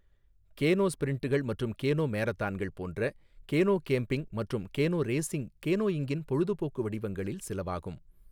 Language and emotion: Tamil, neutral